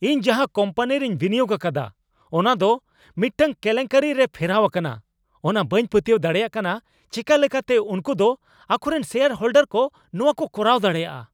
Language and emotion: Santali, angry